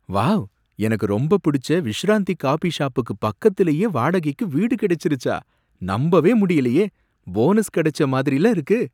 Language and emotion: Tamil, surprised